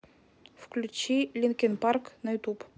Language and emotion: Russian, neutral